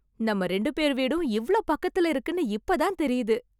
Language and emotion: Tamil, surprised